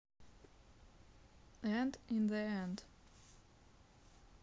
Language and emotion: Russian, neutral